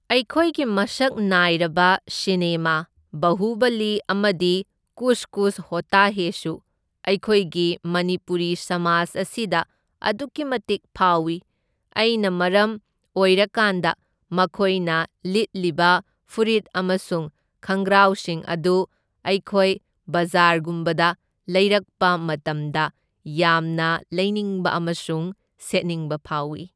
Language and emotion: Manipuri, neutral